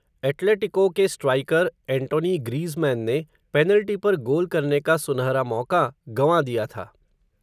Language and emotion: Hindi, neutral